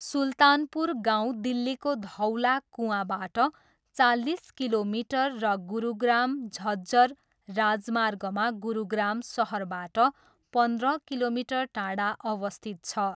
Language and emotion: Nepali, neutral